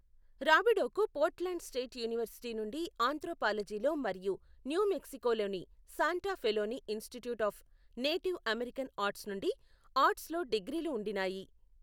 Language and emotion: Telugu, neutral